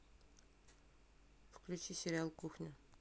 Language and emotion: Russian, neutral